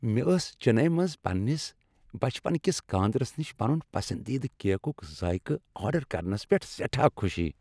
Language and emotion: Kashmiri, happy